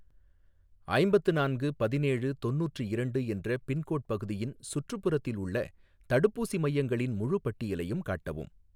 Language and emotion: Tamil, neutral